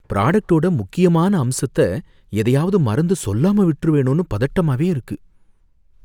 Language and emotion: Tamil, fearful